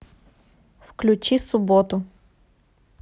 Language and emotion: Russian, neutral